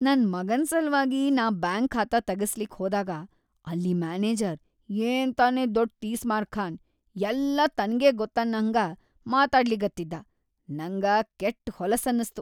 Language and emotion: Kannada, disgusted